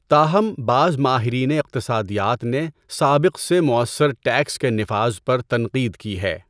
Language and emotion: Urdu, neutral